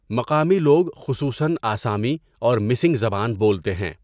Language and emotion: Urdu, neutral